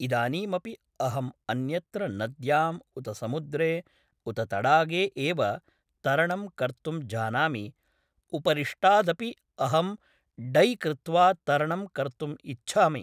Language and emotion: Sanskrit, neutral